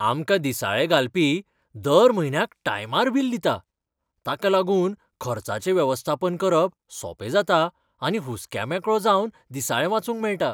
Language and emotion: Goan Konkani, happy